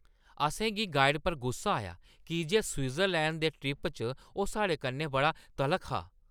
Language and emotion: Dogri, angry